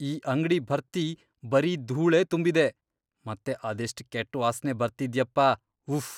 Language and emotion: Kannada, disgusted